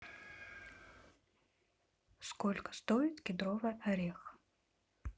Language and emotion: Russian, neutral